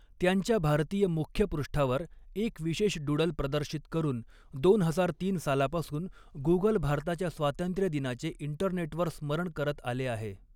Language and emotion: Marathi, neutral